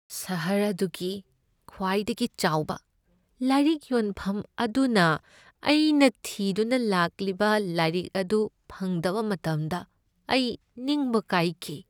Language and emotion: Manipuri, sad